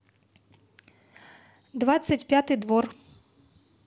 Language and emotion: Russian, neutral